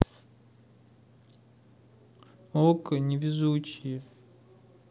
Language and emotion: Russian, sad